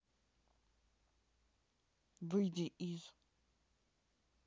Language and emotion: Russian, neutral